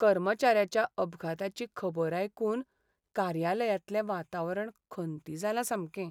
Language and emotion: Goan Konkani, sad